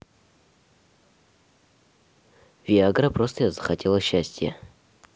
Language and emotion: Russian, neutral